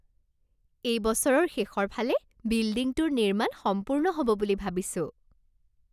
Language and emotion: Assamese, happy